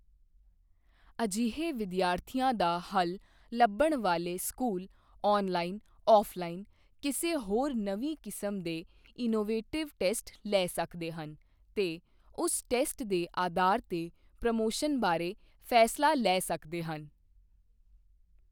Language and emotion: Punjabi, neutral